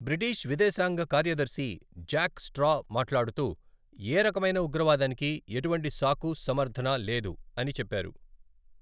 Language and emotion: Telugu, neutral